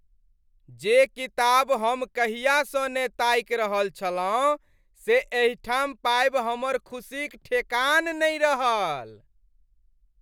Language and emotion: Maithili, happy